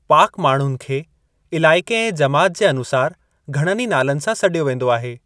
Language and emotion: Sindhi, neutral